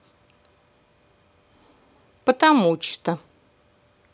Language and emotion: Russian, neutral